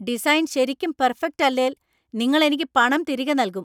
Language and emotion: Malayalam, angry